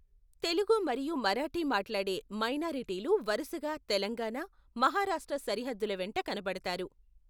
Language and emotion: Telugu, neutral